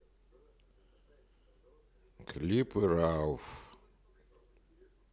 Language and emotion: Russian, neutral